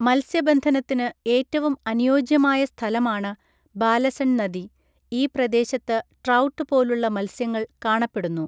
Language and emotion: Malayalam, neutral